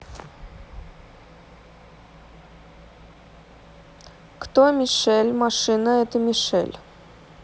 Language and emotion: Russian, neutral